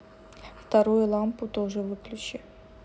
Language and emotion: Russian, neutral